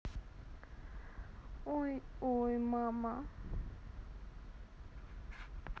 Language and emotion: Russian, sad